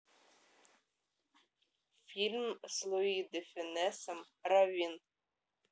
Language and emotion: Russian, neutral